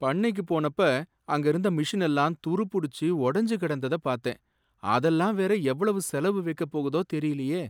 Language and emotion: Tamil, sad